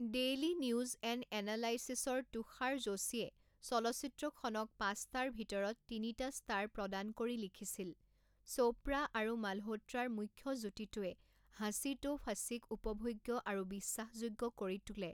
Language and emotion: Assamese, neutral